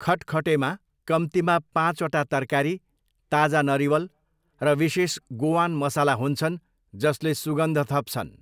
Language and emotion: Nepali, neutral